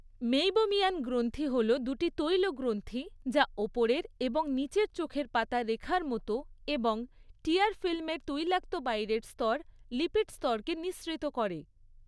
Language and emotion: Bengali, neutral